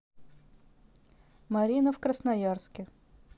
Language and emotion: Russian, neutral